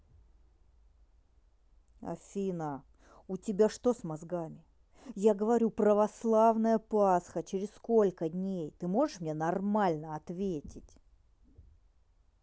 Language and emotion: Russian, angry